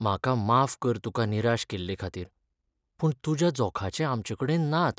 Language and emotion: Goan Konkani, sad